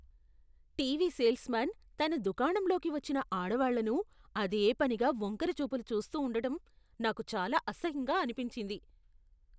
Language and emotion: Telugu, disgusted